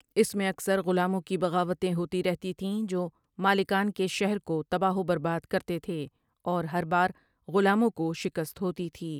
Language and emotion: Urdu, neutral